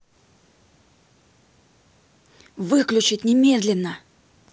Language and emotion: Russian, angry